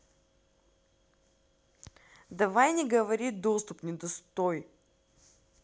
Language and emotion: Russian, angry